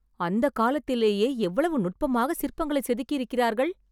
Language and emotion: Tamil, surprised